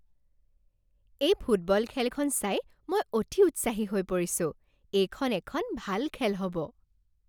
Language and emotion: Assamese, happy